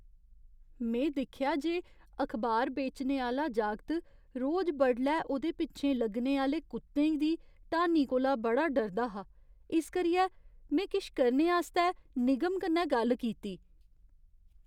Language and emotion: Dogri, fearful